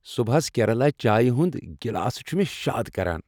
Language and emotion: Kashmiri, happy